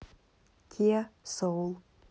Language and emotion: Russian, neutral